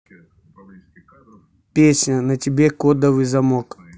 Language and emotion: Russian, neutral